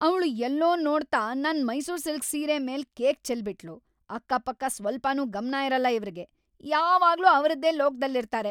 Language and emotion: Kannada, angry